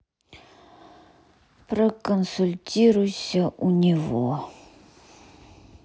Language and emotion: Russian, sad